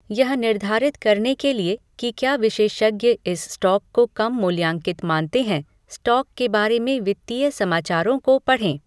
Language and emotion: Hindi, neutral